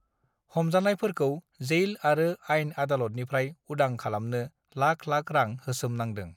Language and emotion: Bodo, neutral